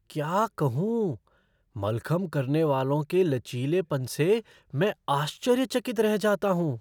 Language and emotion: Hindi, surprised